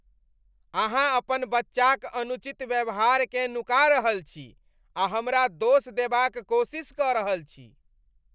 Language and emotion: Maithili, disgusted